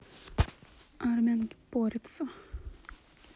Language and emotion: Russian, neutral